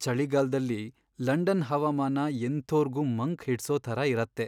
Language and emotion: Kannada, sad